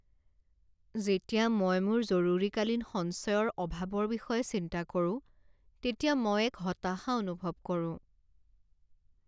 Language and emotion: Assamese, sad